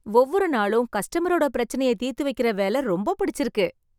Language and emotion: Tamil, happy